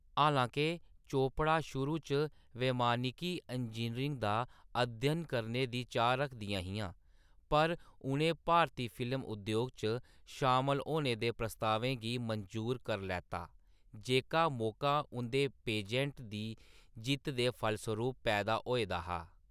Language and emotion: Dogri, neutral